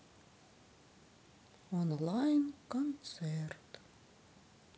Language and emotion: Russian, sad